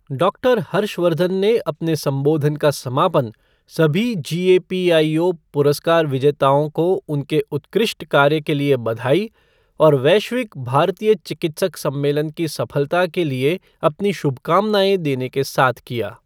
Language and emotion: Hindi, neutral